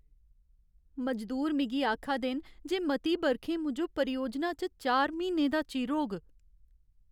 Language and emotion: Dogri, sad